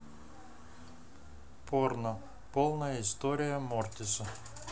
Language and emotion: Russian, neutral